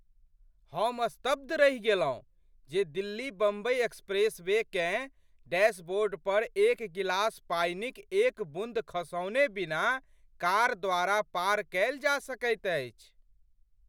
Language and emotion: Maithili, surprised